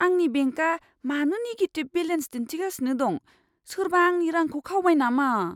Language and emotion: Bodo, fearful